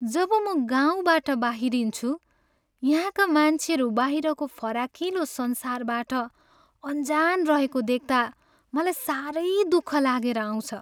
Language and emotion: Nepali, sad